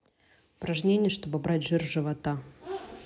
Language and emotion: Russian, neutral